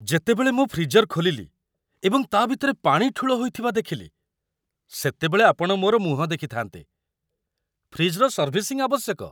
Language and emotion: Odia, surprised